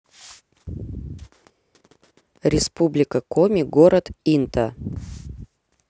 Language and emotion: Russian, neutral